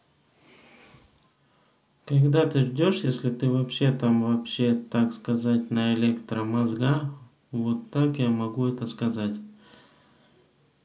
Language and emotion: Russian, neutral